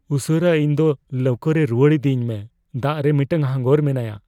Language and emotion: Santali, fearful